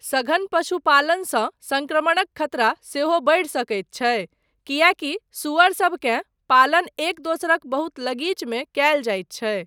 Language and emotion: Maithili, neutral